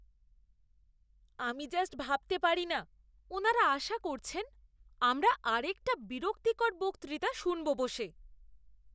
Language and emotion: Bengali, disgusted